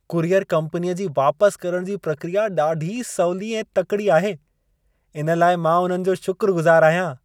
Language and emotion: Sindhi, happy